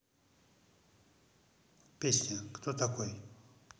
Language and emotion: Russian, neutral